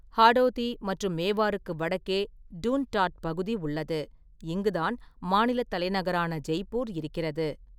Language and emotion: Tamil, neutral